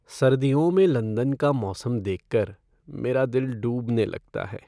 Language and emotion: Hindi, sad